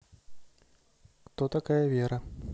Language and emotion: Russian, neutral